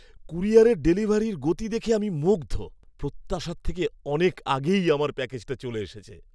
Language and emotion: Bengali, happy